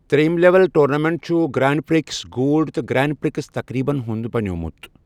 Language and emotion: Kashmiri, neutral